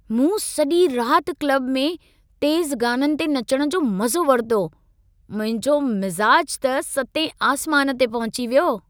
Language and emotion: Sindhi, happy